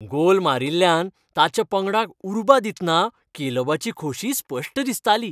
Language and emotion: Goan Konkani, happy